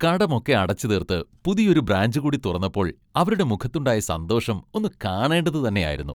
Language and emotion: Malayalam, happy